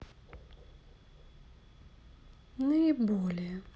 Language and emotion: Russian, neutral